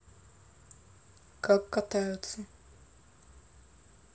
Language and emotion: Russian, neutral